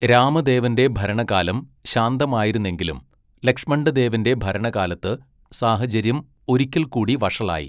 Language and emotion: Malayalam, neutral